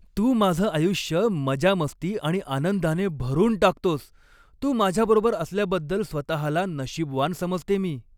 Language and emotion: Marathi, happy